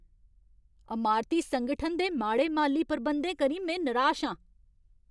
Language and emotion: Dogri, angry